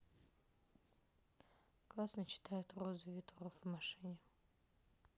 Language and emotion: Russian, neutral